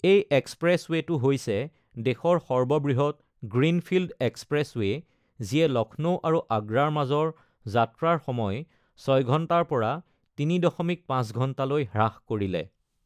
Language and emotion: Assamese, neutral